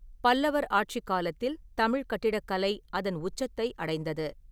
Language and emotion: Tamil, neutral